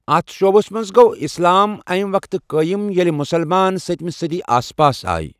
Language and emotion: Kashmiri, neutral